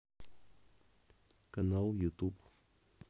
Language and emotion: Russian, neutral